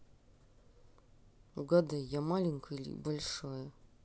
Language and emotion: Russian, neutral